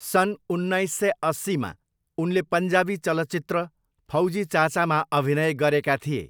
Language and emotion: Nepali, neutral